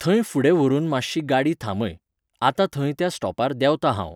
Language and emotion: Goan Konkani, neutral